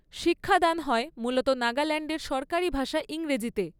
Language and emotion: Bengali, neutral